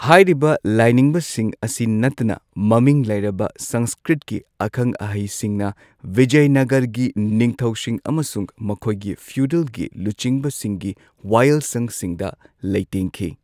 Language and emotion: Manipuri, neutral